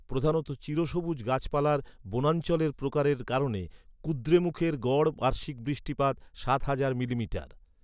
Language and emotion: Bengali, neutral